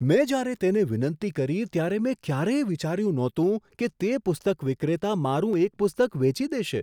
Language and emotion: Gujarati, surprised